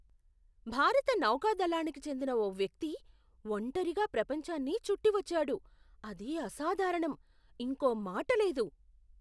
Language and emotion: Telugu, surprised